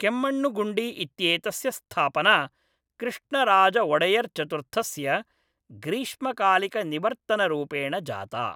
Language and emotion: Sanskrit, neutral